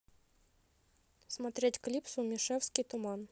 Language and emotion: Russian, neutral